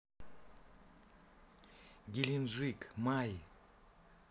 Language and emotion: Russian, neutral